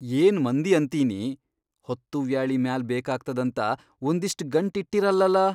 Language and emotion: Kannada, surprised